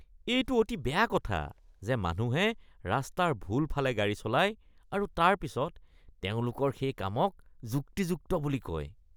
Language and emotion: Assamese, disgusted